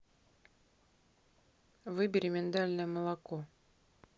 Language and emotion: Russian, neutral